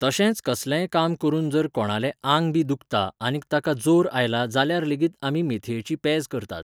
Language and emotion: Goan Konkani, neutral